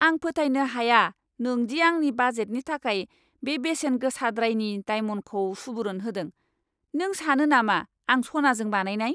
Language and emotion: Bodo, angry